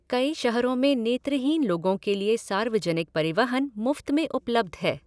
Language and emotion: Hindi, neutral